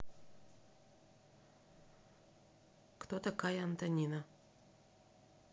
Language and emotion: Russian, neutral